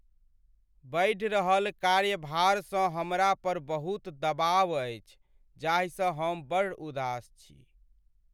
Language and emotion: Maithili, sad